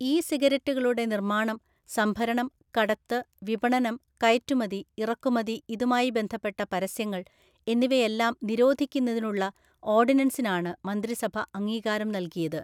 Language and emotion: Malayalam, neutral